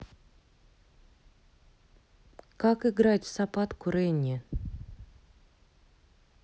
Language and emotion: Russian, neutral